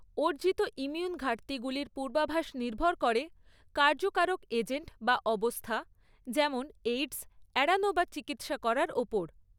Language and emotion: Bengali, neutral